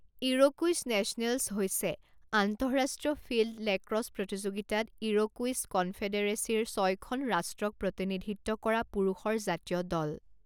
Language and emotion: Assamese, neutral